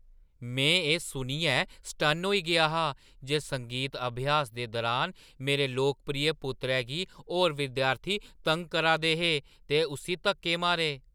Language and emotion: Dogri, surprised